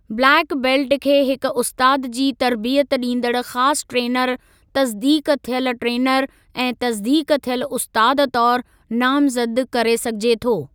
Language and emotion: Sindhi, neutral